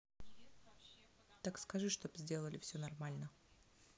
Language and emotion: Russian, neutral